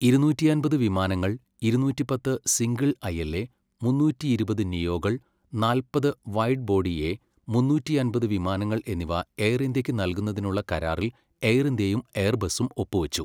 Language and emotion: Malayalam, neutral